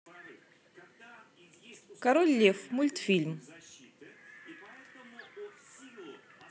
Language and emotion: Russian, positive